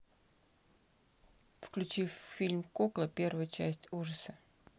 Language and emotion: Russian, neutral